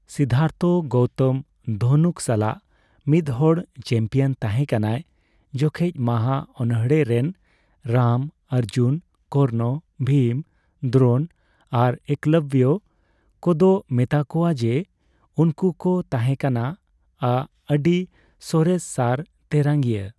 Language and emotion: Santali, neutral